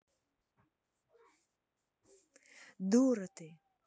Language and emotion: Russian, neutral